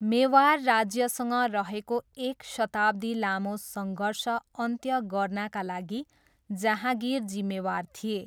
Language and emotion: Nepali, neutral